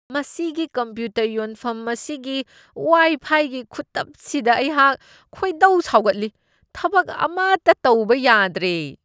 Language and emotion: Manipuri, disgusted